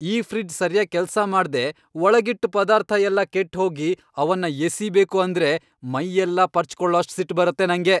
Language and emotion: Kannada, angry